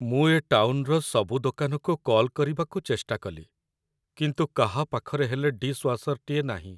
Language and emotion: Odia, sad